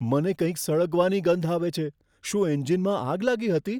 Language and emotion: Gujarati, fearful